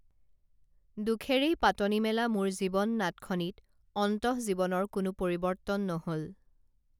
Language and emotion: Assamese, neutral